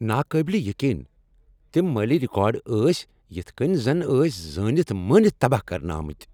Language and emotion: Kashmiri, angry